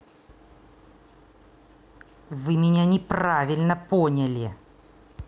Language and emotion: Russian, angry